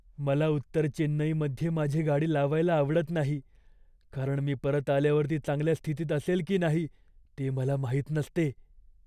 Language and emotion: Marathi, fearful